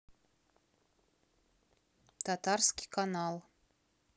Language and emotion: Russian, neutral